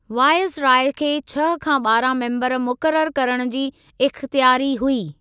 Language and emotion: Sindhi, neutral